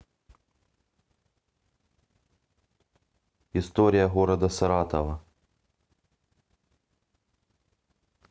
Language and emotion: Russian, neutral